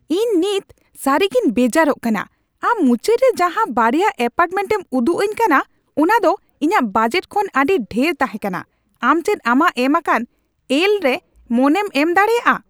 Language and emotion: Santali, angry